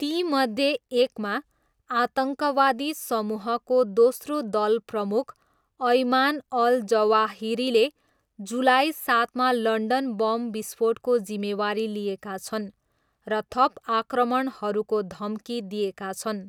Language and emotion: Nepali, neutral